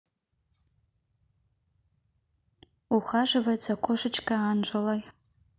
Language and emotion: Russian, neutral